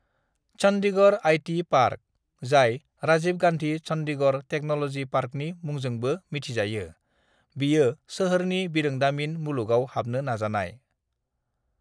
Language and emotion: Bodo, neutral